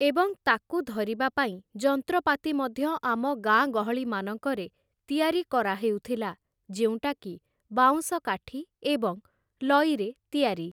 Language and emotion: Odia, neutral